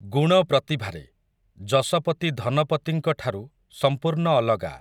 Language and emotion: Odia, neutral